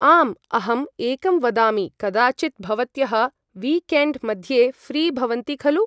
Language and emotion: Sanskrit, neutral